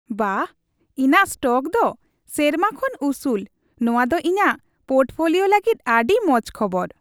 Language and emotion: Santali, happy